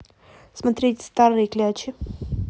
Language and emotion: Russian, neutral